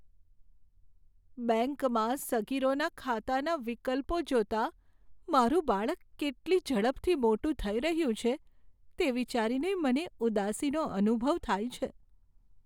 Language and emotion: Gujarati, sad